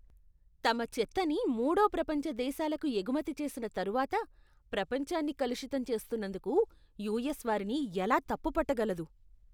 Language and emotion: Telugu, disgusted